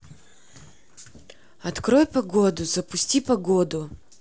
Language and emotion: Russian, neutral